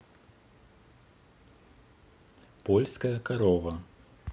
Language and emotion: Russian, neutral